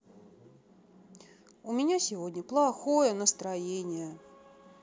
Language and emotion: Russian, sad